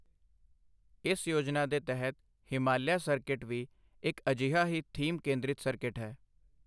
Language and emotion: Punjabi, neutral